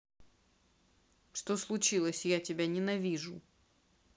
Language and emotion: Russian, neutral